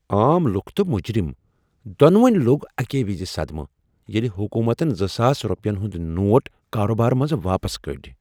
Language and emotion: Kashmiri, surprised